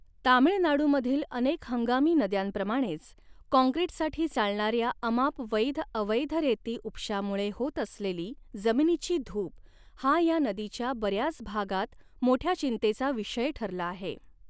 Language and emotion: Marathi, neutral